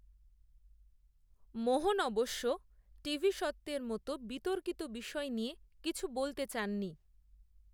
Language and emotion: Bengali, neutral